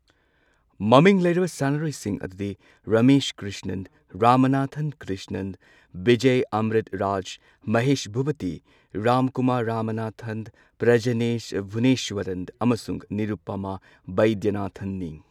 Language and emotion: Manipuri, neutral